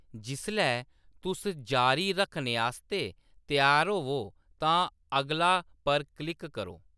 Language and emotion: Dogri, neutral